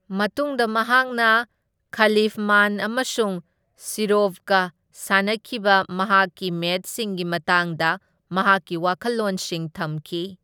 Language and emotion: Manipuri, neutral